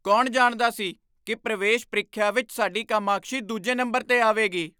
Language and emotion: Punjabi, surprised